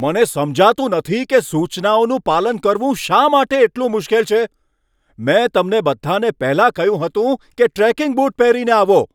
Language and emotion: Gujarati, angry